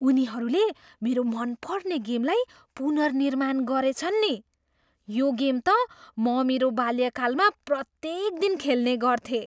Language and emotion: Nepali, surprised